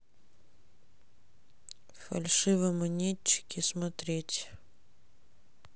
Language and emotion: Russian, sad